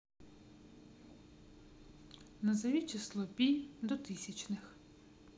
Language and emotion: Russian, neutral